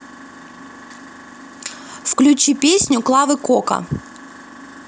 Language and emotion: Russian, neutral